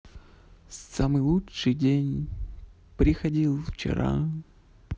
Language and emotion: Russian, neutral